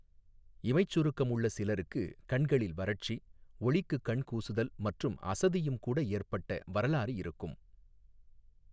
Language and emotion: Tamil, neutral